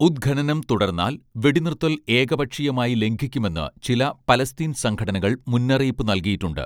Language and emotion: Malayalam, neutral